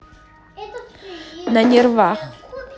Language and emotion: Russian, neutral